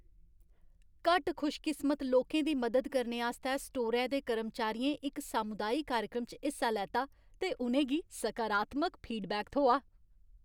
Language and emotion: Dogri, happy